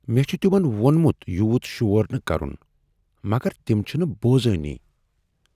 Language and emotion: Kashmiri, sad